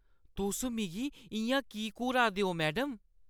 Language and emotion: Dogri, disgusted